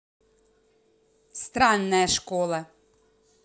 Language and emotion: Russian, angry